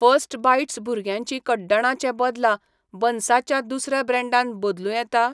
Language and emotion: Goan Konkani, neutral